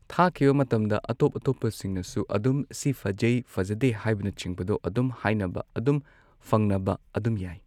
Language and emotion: Manipuri, neutral